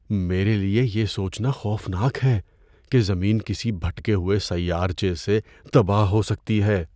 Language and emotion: Urdu, fearful